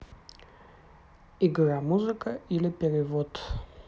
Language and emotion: Russian, neutral